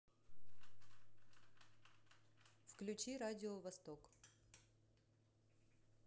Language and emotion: Russian, neutral